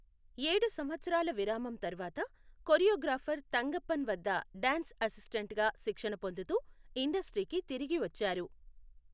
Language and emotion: Telugu, neutral